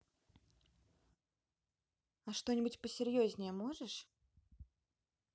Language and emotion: Russian, neutral